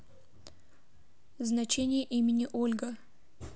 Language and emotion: Russian, neutral